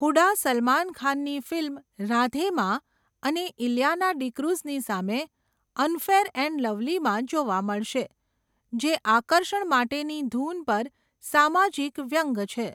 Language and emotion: Gujarati, neutral